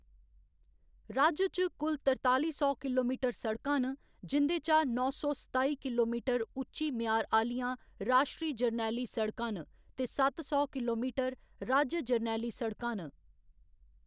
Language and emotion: Dogri, neutral